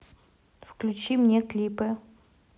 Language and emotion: Russian, neutral